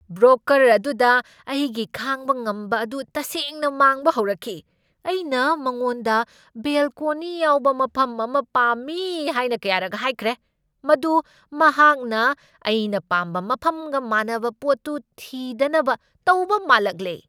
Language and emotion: Manipuri, angry